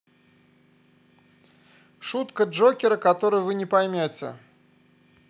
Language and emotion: Russian, neutral